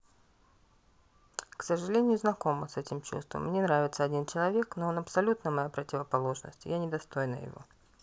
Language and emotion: Russian, neutral